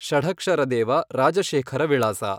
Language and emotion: Kannada, neutral